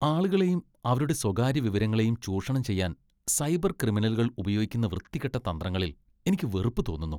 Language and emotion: Malayalam, disgusted